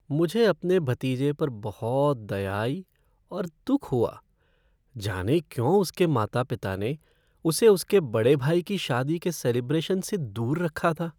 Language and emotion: Hindi, sad